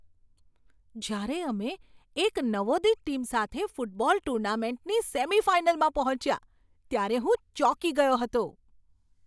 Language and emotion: Gujarati, surprised